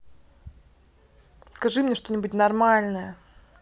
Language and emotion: Russian, angry